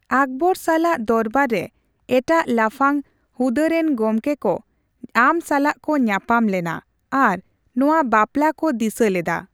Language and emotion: Santali, neutral